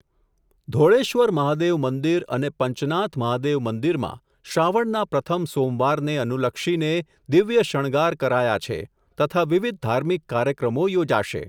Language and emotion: Gujarati, neutral